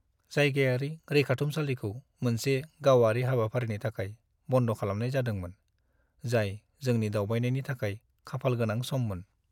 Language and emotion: Bodo, sad